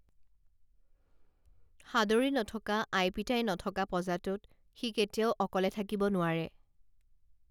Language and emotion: Assamese, neutral